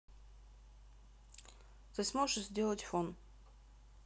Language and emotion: Russian, neutral